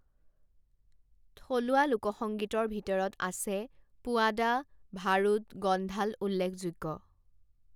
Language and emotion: Assamese, neutral